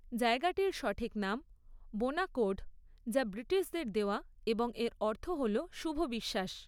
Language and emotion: Bengali, neutral